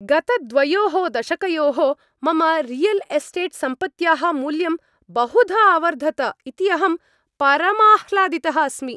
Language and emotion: Sanskrit, happy